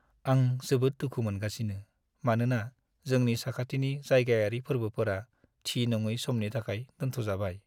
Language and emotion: Bodo, sad